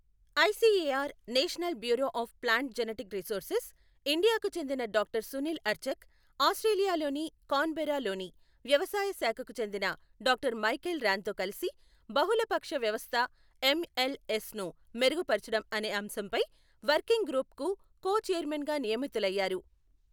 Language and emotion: Telugu, neutral